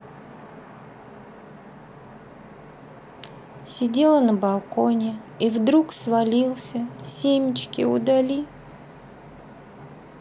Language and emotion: Russian, sad